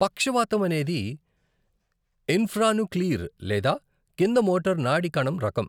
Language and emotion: Telugu, neutral